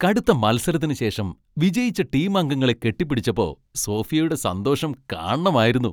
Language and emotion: Malayalam, happy